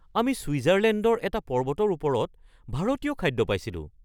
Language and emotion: Assamese, surprised